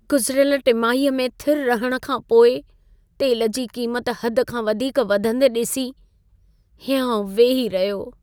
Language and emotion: Sindhi, sad